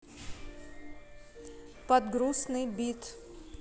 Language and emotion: Russian, neutral